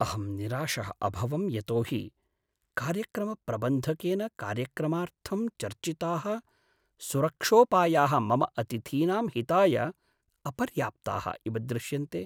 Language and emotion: Sanskrit, sad